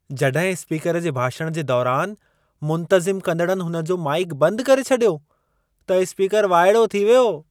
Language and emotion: Sindhi, surprised